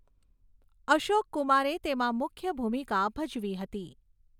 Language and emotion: Gujarati, neutral